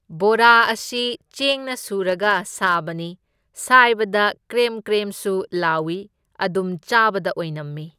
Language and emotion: Manipuri, neutral